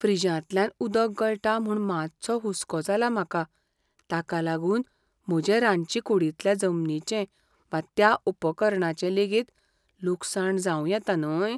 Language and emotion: Goan Konkani, fearful